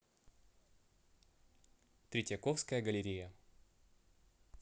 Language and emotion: Russian, neutral